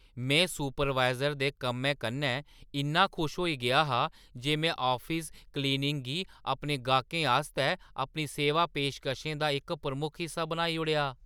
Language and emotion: Dogri, surprised